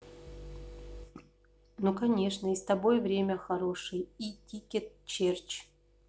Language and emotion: Russian, neutral